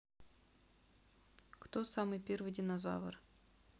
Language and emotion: Russian, neutral